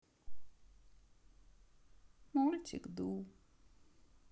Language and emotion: Russian, sad